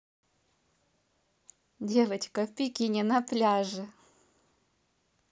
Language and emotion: Russian, positive